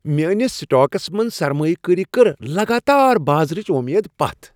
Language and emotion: Kashmiri, happy